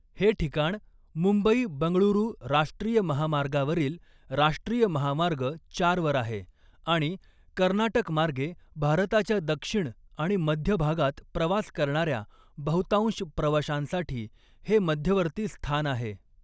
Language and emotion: Marathi, neutral